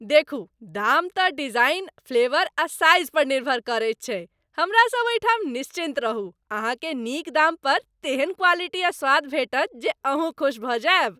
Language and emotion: Maithili, happy